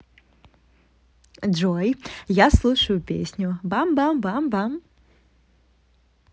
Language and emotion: Russian, positive